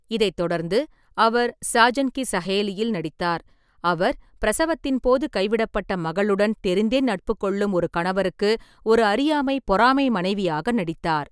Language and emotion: Tamil, neutral